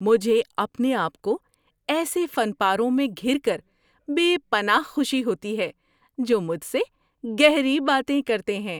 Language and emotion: Urdu, happy